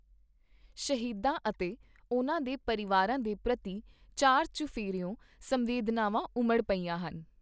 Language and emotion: Punjabi, neutral